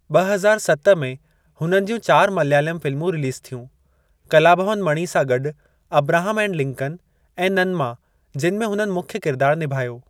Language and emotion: Sindhi, neutral